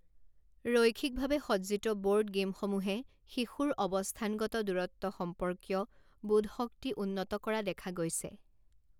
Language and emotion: Assamese, neutral